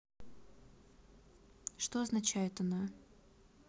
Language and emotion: Russian, neutral